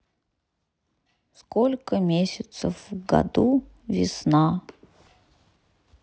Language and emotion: Russian, sad